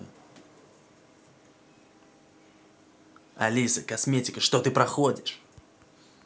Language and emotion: Russian, angry